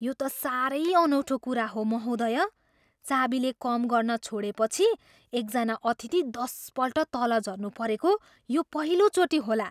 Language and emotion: Nepali, surprised